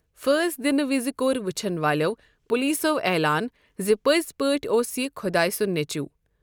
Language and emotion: Kashmiri, neutral